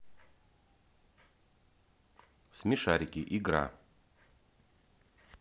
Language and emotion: Russian, neutral